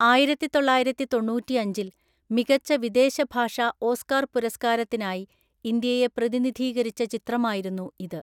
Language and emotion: Malayalam, neutral